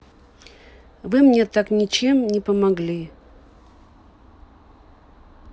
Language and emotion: Russian, neutral